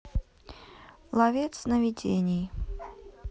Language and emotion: Russian, neutral